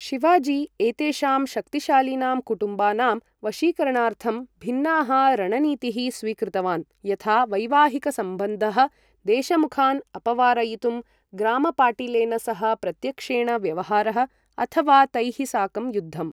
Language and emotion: Sanskrit, neutral